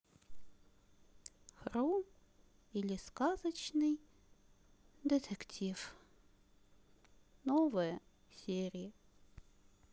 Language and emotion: Russian, sad